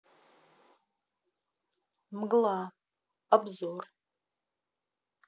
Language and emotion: Russian, neutral